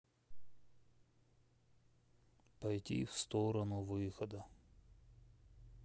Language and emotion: Russian, sad